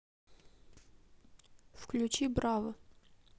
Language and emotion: Russian, neutral